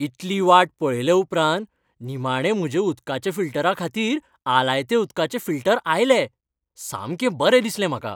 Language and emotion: Goan Konkani, happy